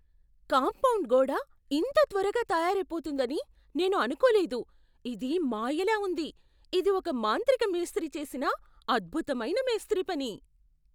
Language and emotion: Telugu, surprised